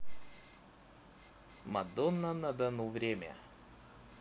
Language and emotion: Russian, positive